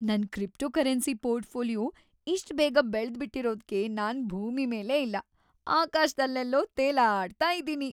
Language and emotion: Kannada, happy